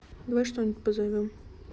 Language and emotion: Russian, neutral